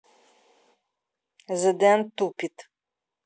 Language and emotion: Russian, angry